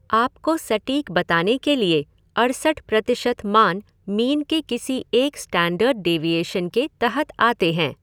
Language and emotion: Hindi, neutral